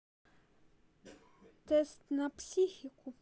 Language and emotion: Russian, neutral